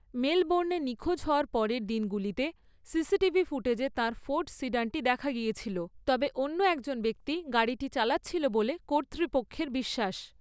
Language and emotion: Bengali, neutral